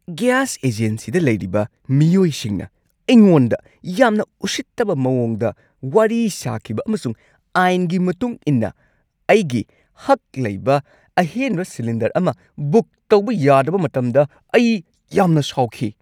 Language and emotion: Manipuri, angry